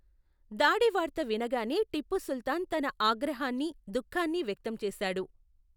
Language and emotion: Telugu, neutral